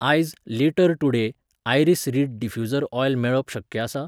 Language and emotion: Goan Konkani, neutral